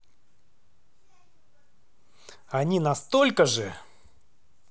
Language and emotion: Russian, angry